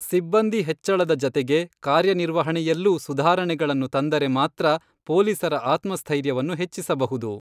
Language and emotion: Kannada, neutral